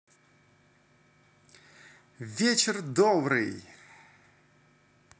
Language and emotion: Russian, positive